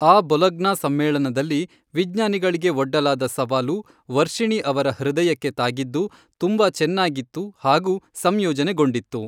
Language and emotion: Kannada, neutral